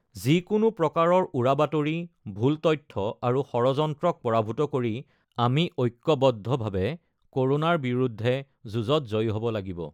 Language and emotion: Assamese, neutral